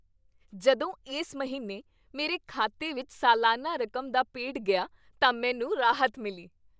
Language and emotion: Punjabi, happy